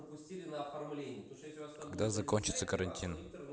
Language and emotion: Russian, neutral